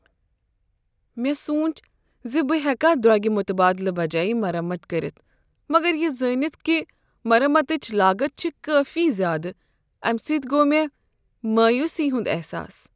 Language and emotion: Kashmiri, sad